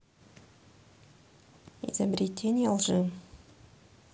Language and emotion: Russian, neutral